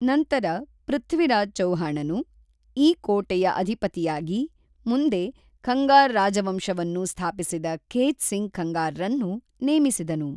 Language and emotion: Kannada, neutral